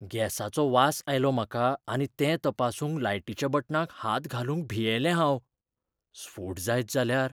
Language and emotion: Goan Konkani, fearful